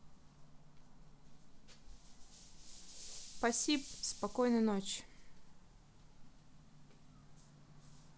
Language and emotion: Russian, neutral